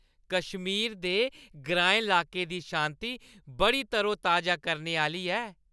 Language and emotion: Dogri, happy